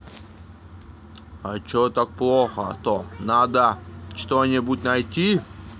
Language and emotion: Russian, neutral